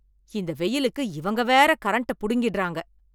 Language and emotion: Tamil, angry